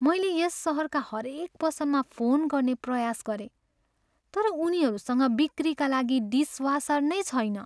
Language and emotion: Nepali, sad